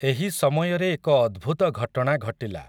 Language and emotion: Odia, neutral